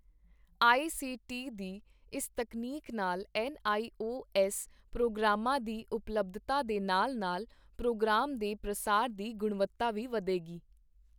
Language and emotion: Punjabi, neutral